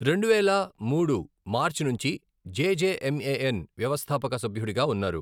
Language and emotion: Telugu, neutral